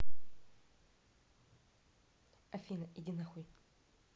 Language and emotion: Russian, angry